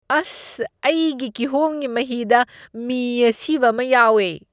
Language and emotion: Manipuri, disgusted